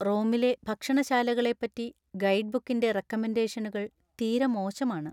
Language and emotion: Malayalam, sad